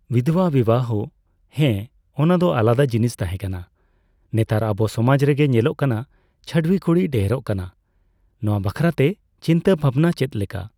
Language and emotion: Santali, neutral